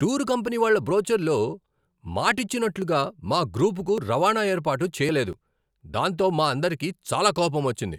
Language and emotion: Telugu, angry